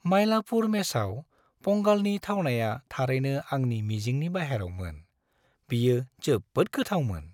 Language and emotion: Bodo, happy